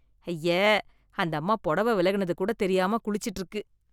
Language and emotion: Tamil, disgusted